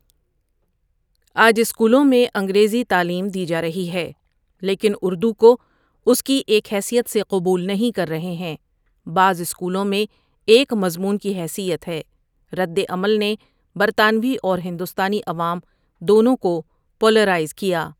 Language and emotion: Urdu, neutral